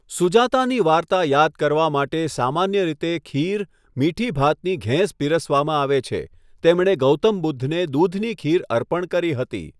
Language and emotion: Gujarati, neutral